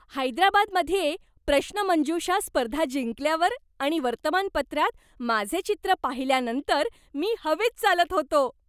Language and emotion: Marathi, happy